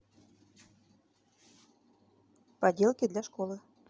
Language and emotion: Russian, neutral